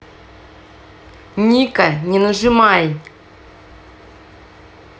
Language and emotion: Russian, angry